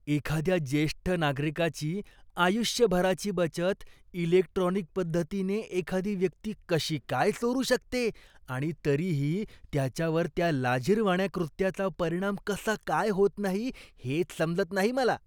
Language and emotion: Marathi, disgusted